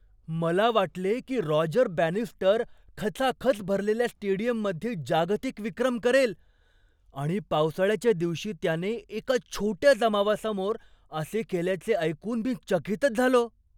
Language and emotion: Marathi, surprised